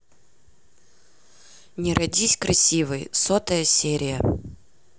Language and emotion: Russian, neutral